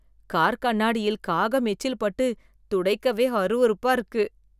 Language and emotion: Tamil, disgusted